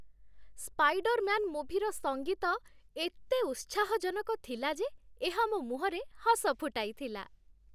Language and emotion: Odia, happy